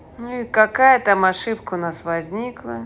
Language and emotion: Russian, angry